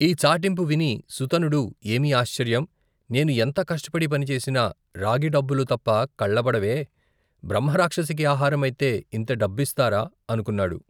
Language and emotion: Telugu, neutral